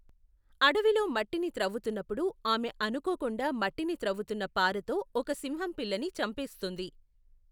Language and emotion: Telugu, neutral